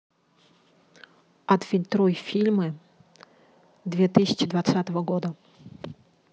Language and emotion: Russian, neutral